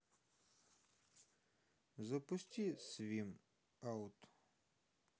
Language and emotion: Russian, neutral